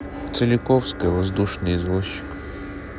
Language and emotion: Russian, neutral